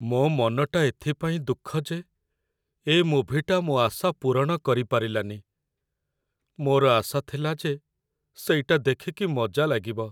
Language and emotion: Odia, sad